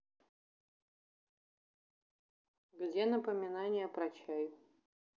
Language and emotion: Russian, neutral